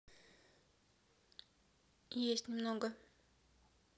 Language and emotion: Russian, neutral